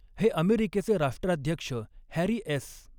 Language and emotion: Marathi, neutral